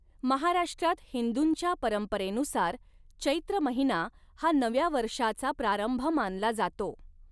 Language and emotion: Marathi, neutral